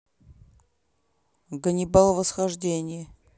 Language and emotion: Russian, neutral